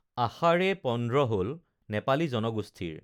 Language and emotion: Assamese, neutral